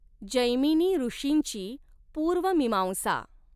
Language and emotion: Marathi, neutral